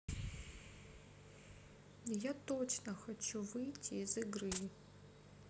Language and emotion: Russian, sad